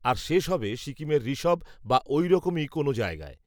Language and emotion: Bengali, neutral